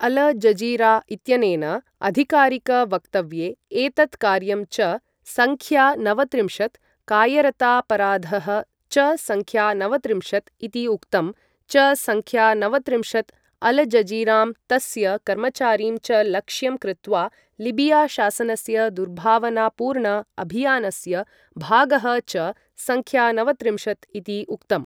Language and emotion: Sanskrit, neutral